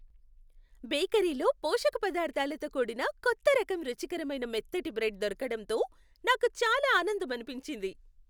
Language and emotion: Telugu, happy